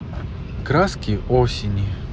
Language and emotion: Russian, neutral